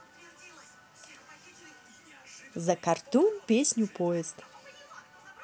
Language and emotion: Russian, positive